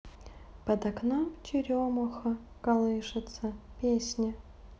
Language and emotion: Russian, sad